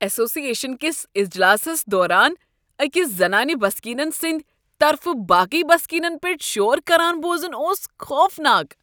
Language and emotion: Kashmiri, disgusted